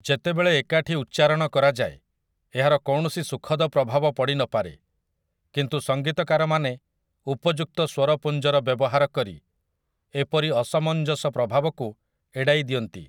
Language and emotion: Odia, neutral